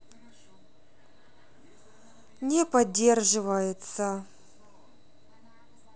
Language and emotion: Russian, sad